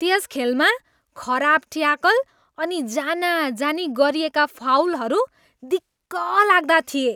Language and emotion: Nepali, disgusted